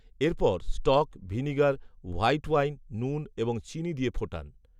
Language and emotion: Bengali, neutral